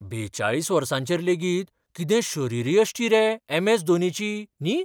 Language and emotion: Goan Konkani, surprised